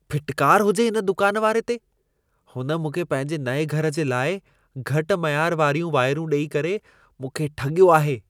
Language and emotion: Sindhi, disgusted